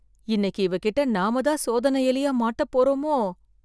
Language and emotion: Tamil, fearful